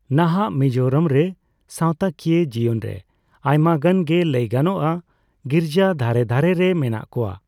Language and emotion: Santali, neutral